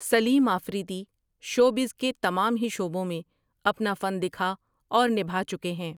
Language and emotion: Urdu, neutral